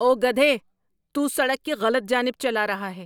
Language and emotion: Urdu, angry